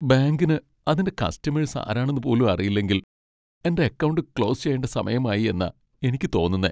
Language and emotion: Malayalam, sad